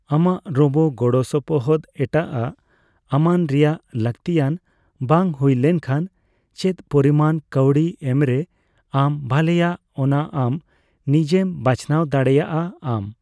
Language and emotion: Santali, neutral